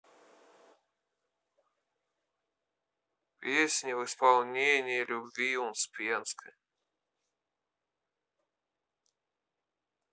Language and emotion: Russian, neutral